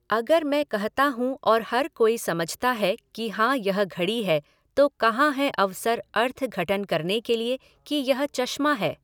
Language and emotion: Hindi, neutral